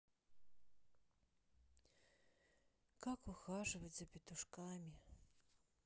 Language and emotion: Russian, sad